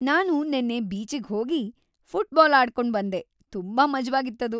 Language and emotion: Kannada, happy